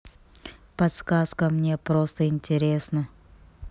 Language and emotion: Russian, neutral